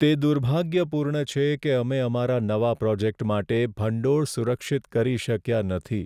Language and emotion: Gujarati, sad